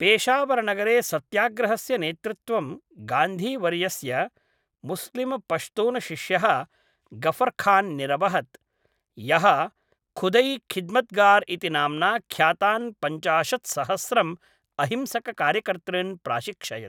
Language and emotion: Sanskrit, neutral